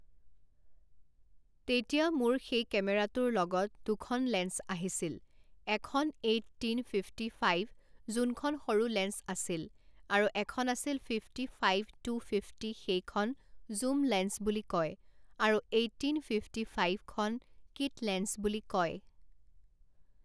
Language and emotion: Assamese, neutral